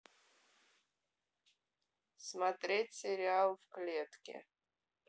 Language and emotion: Russian, neutral